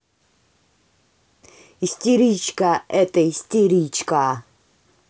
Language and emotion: Russian, angry